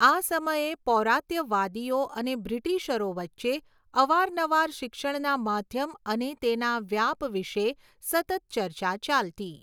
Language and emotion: Gujarati, neutral